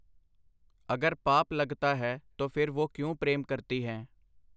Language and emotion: Punjabi, neutral